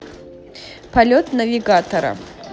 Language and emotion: Russian, neutral